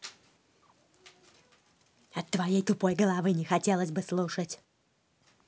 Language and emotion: Russian, angry